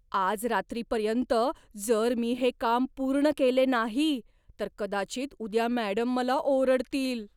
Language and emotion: Marathi, fearful